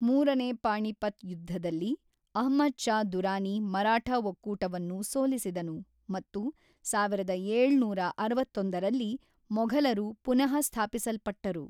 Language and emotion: Kannada, neutral